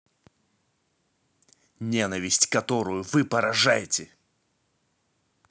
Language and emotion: Russian, angry